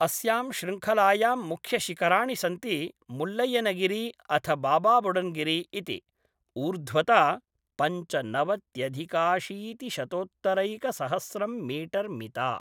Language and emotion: Sanskrit, neutral